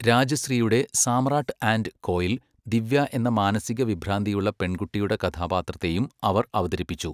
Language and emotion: Malayalam, neutral